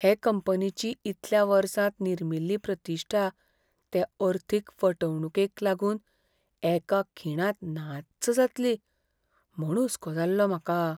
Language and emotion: Goan Konkani, fearful